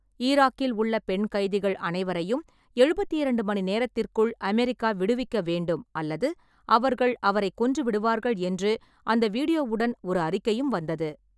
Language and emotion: Tamil, neutral